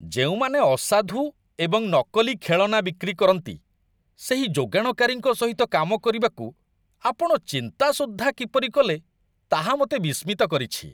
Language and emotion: Odia, disgusted